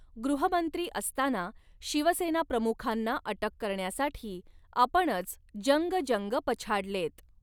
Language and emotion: Marathi, neutral